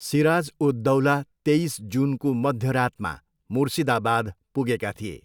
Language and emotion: Nepali, neutral